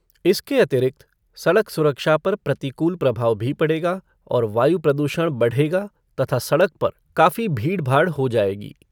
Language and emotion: Hindi, neutral